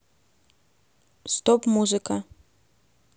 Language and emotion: Russian, neutral